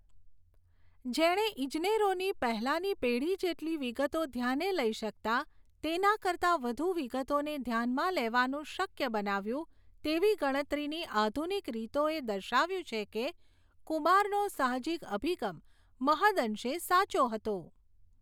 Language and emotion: Gujarati, neutral